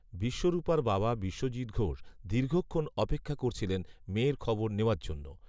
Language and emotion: Bengali, neutral